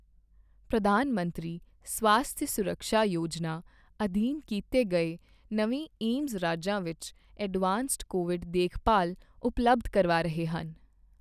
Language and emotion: Punjabi, neutral